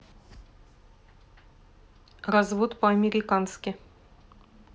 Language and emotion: Russian, neutral